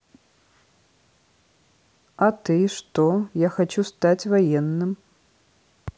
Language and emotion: Russian, neutral